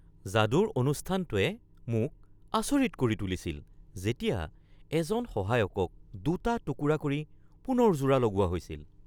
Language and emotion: Assamese, surprised